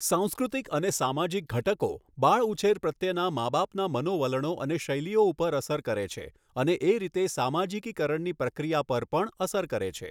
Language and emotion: Gujarati, neutral